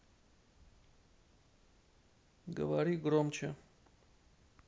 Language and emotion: Russian, neutral